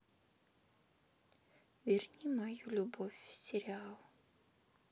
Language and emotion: Russian, sad